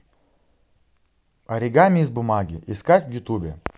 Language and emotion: Russian, positive